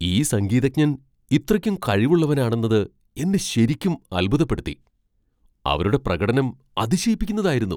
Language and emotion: Malayalam, surprised